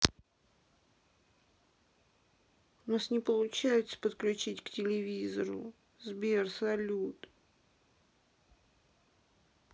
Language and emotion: Russian, sad